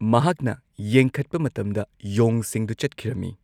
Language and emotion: Manipuri, neutral